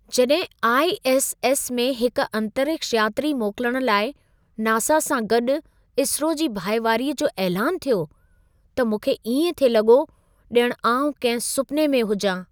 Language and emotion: Sindhi, surprised